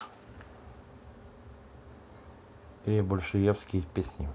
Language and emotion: Russian, neutral